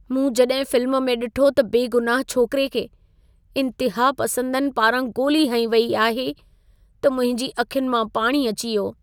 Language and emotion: Sindhi, sad